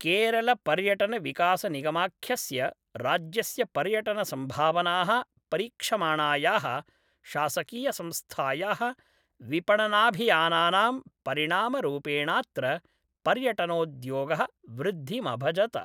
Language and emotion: Sanskrit, neutral